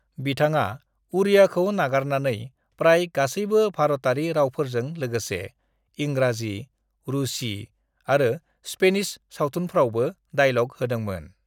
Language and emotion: Bodo, neutral